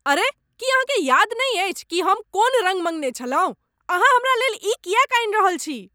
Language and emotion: Maithili, angry